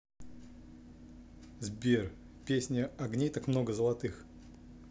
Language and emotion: Russian, neutral